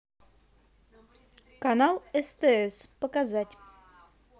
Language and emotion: Russian, positive